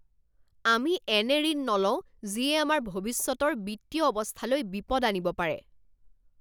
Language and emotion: Assamese, angry